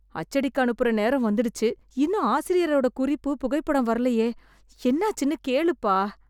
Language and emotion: Tamil, fearful